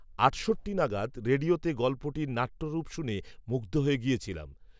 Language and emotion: Bengali, neutral